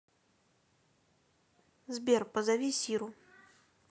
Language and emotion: Russian, neutral